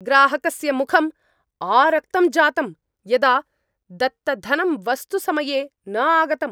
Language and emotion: Sanskrit, angry